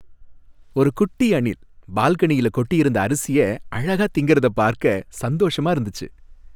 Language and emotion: Tamil, happy